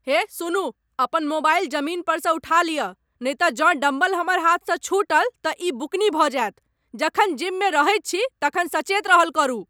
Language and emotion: Maithili, angry